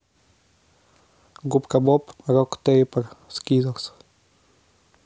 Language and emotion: Russian, neutral